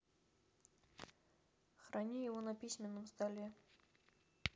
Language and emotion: Russian, neutral